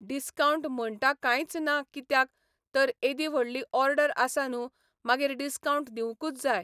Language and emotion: Goan Konkani, neutral